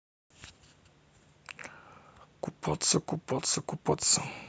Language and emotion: Russian, neutral